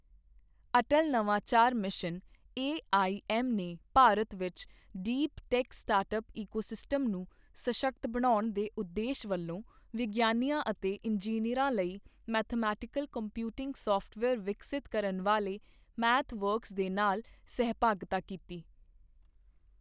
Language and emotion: Punjabi, neutral